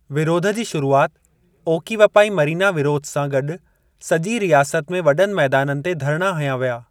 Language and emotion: Sindhi, neutral